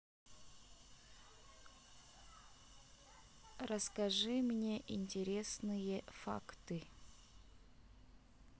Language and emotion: Russian, neutral